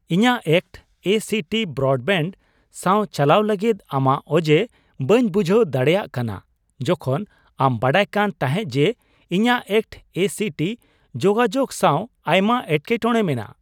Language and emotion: Santali, surprised